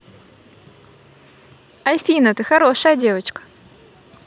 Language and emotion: Russian, positive